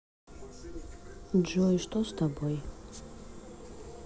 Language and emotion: Russian, sad